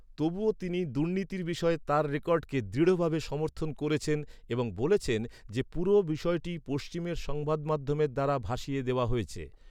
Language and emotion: Bengali, neutral